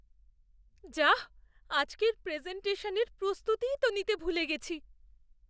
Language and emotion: Bengali, fearful